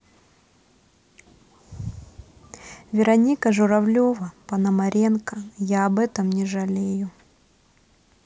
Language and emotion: Russian, neutral